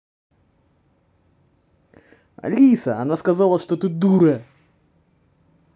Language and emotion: Russian, positive